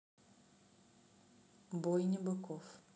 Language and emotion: Russian, neutral